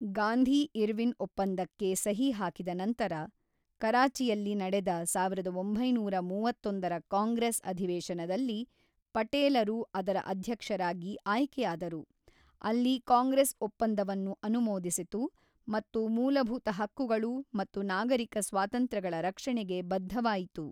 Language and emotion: Kannada, neutral